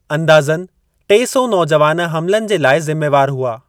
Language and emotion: Sindhi, neutral